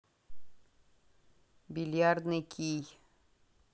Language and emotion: Russian, neutral